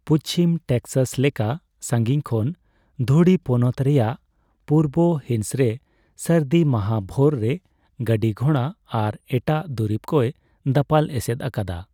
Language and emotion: Santali, neutral